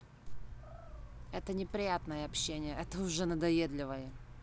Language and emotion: Russian, angry